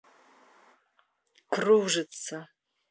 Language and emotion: Russian, neutral